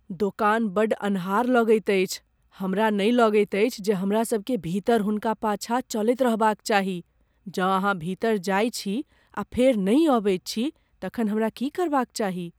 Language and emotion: Maithili, fearful